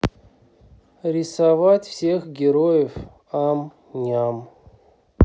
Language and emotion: Russian, sad